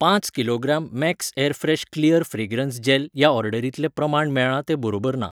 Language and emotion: Goan Konkani, neutral